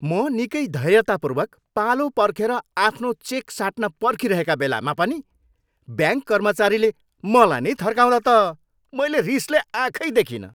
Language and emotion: Nepali, angry